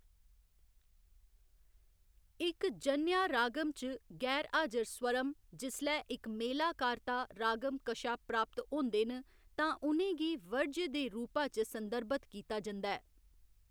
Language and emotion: Dogri, neutral